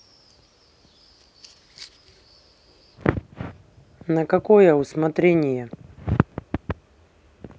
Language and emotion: Russian, neutral